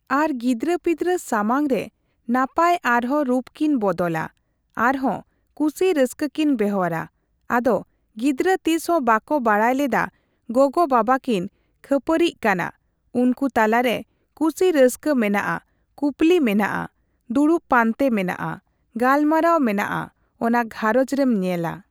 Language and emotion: Santali, neutral